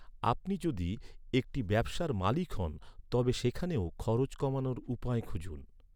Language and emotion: Bengali, neutral